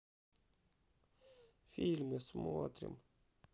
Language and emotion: Russian, sad